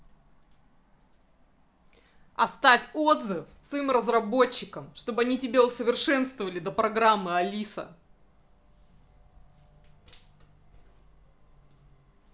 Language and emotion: Russian, angry